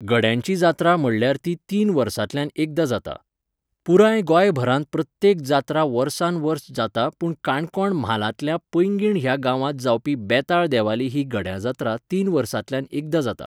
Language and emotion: Goan Konkani, neutral